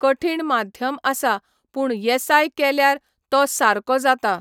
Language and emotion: Goan Konkani, neutral